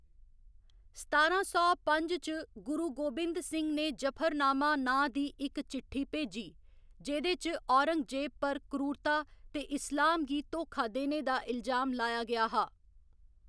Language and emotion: Dogri, neutral